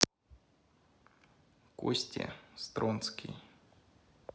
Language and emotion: Russian, neutral